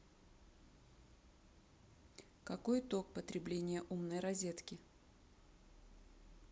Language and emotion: Russian, neutral